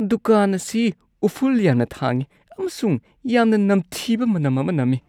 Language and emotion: Manipuri, disgusted